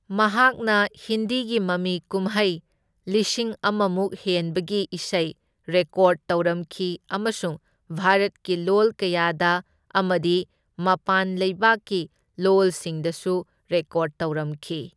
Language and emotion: Manipuri, neutral